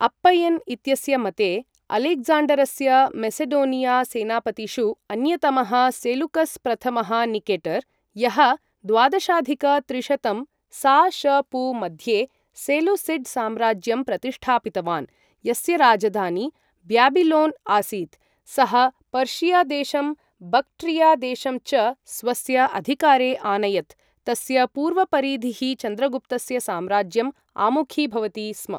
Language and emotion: Sanskrit, neutral